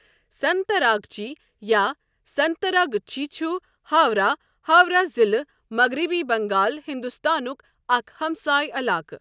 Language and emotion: Kashmiri, neutral